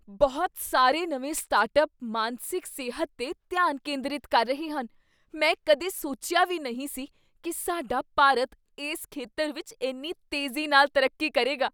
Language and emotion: Punjabi, surprised